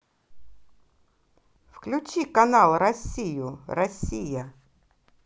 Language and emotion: Russian, positive